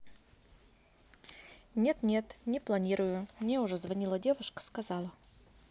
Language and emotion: Russian, neutral